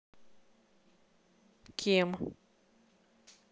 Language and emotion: Russian, neutral